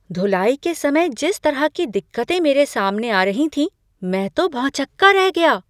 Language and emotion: Hindi, surprised